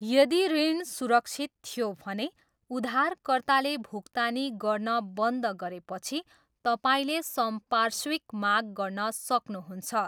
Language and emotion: Nepali, neutral